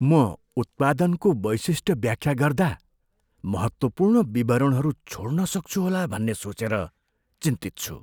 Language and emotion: Nepali, fearful